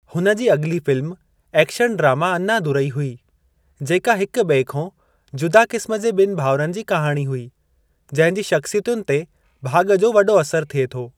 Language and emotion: Sindhi, neutral